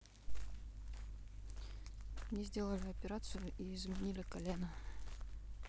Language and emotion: Russian, neutral